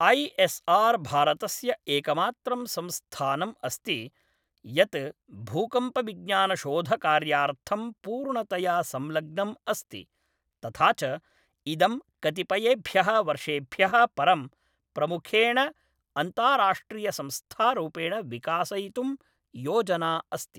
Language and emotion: Sanskrit, neutral